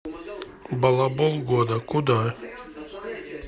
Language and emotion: Russian, neutral